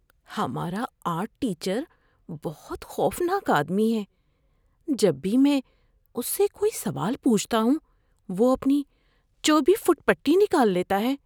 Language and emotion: Urdu, fearful